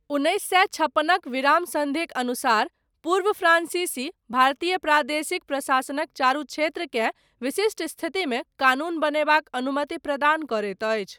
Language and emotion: Maithili, neutral